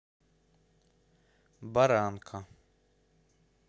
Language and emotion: Russian, neutral